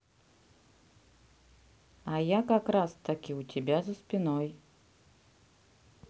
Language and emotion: Russian, neutral